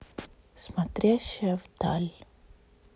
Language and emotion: Russian, sad